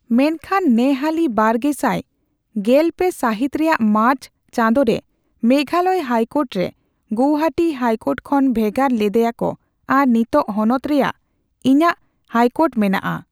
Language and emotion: Santali, neutral